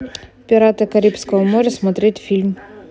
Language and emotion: Russian, neutral